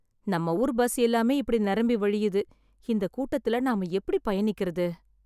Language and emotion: Tamil, sad